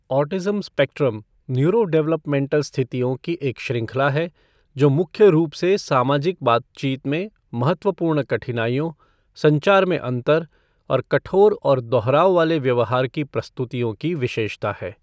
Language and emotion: Hindi, neutral